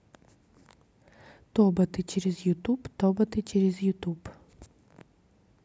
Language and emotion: Russian, neutral